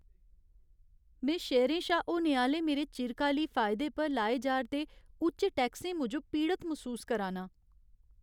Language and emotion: Dogri, sad